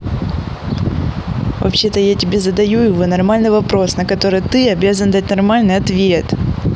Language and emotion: Russian, angry